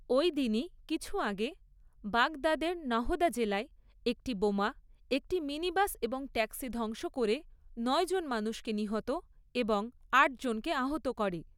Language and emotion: Bengali, neutral